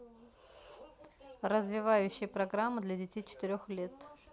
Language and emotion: Russian, neutral